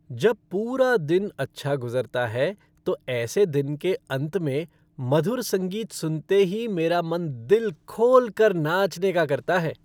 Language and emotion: Hindi, happy